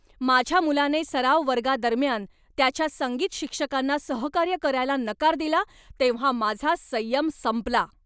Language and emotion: Marathi, angry